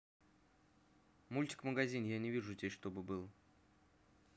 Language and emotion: Russian, neutral